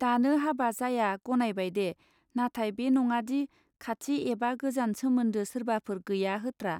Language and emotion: Bodo, neutral